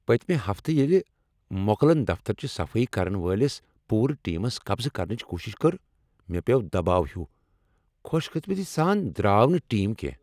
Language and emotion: Kashmiri, angry